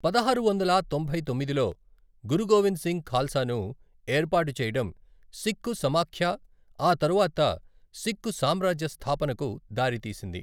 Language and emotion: Telugu, neutral